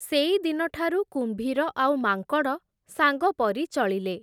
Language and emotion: Odia, neutral